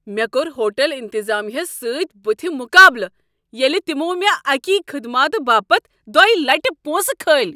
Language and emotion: Kashmiri, angry